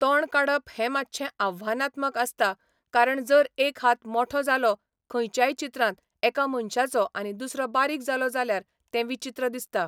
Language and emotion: Goan Konkani, neutral